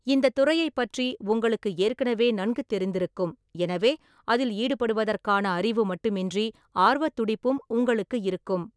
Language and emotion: Tamil, neutral